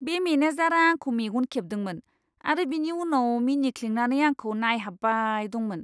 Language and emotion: Bodo, disgusted